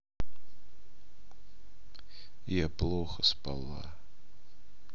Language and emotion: Russian, sad